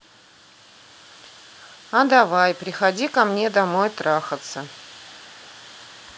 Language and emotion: Russian, neutral